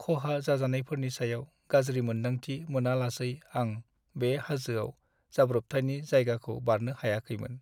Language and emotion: Bodo, sad